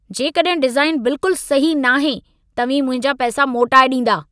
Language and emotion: Sindhi, angry